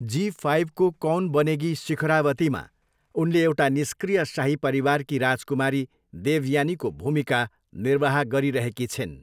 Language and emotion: Nepali, neutral